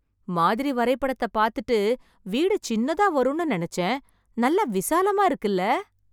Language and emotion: Tamil, surprised